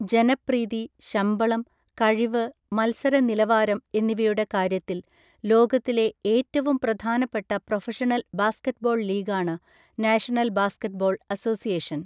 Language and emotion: Malayalam, neutral